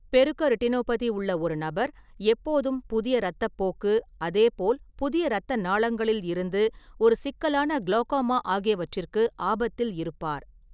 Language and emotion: Tamil, neutral